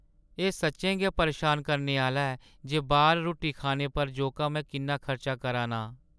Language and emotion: Dogri, sad